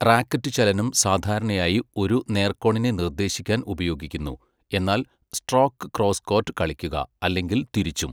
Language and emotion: Malayalam, neutral